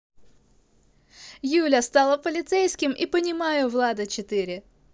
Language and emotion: Russian, positive